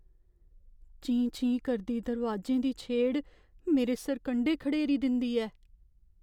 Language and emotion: Dogri, fearful